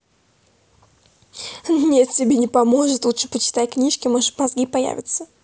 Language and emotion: Russian, positive